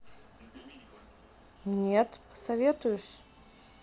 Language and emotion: Russian, neutral